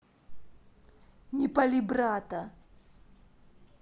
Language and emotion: Russian, angry